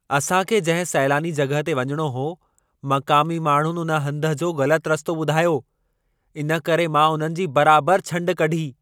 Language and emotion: Sindhi, angry